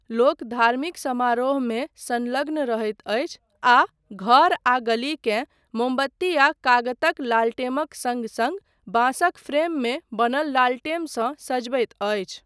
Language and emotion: Maithili, neutral